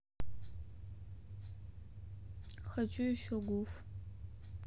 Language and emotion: Russian, sad